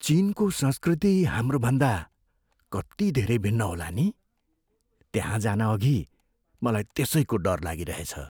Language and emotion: Nepali, fearful